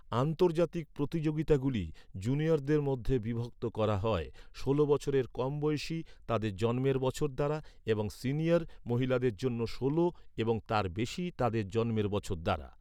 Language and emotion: Bengali, neutral